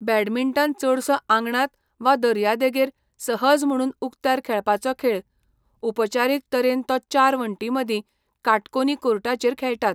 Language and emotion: Goan Konkani, neutral